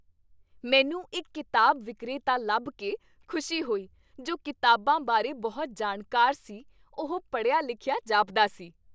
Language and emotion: Punjabi, happy